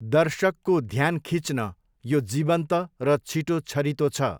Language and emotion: Nepali, neutral